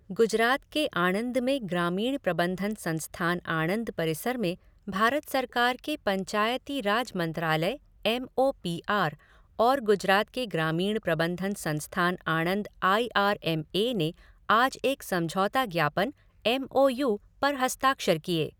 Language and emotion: Hindi, neutral